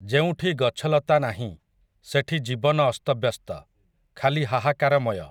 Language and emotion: Odia, neutral